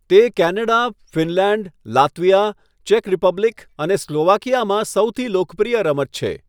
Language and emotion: Gujarati, neutral